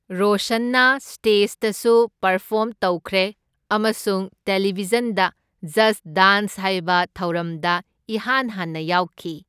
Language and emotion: Manipuri, neutral